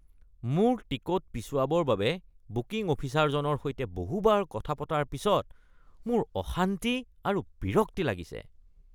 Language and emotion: Assamese, disgusted